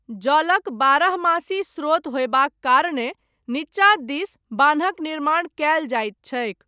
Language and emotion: Maithili, neutral